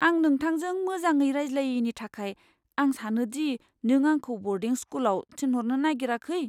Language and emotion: Bodo, fearful